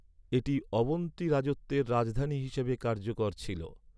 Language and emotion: Bengali, neutral